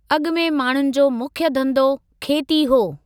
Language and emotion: Sindhi, neutral